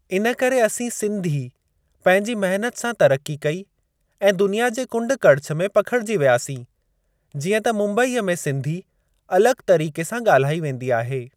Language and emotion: Sindhi, neutral